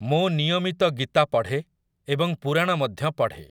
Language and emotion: Odia, neutral